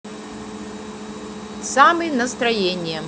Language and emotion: Russian, neutral